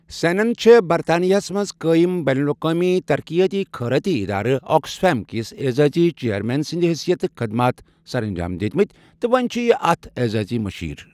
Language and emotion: Kashmiri, neutral